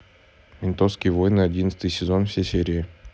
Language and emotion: Russian, neutral